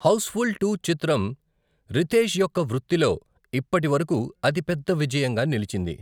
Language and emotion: Telugu, neutral